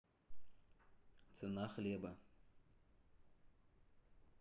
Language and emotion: Russian, neutral